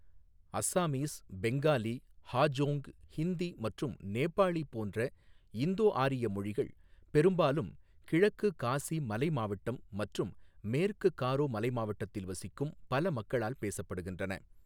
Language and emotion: Tamil, neutral